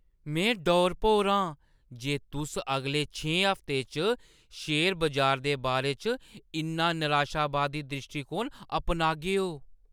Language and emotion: Dogri, surprised